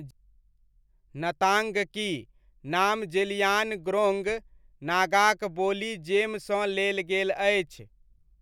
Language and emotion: Maithili, neutral